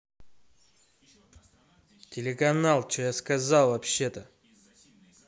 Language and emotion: Russian, angry